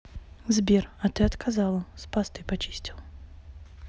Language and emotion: Russian, neutral